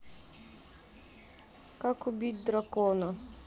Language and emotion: Russian, neutral